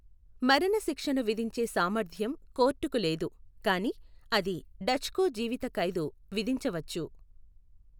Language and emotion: Telugu, neutral